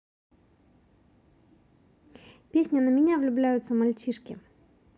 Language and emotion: Russian, positive